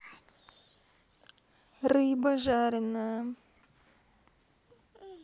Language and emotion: Russian, neutral